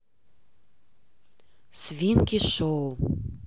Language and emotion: Russian, neutral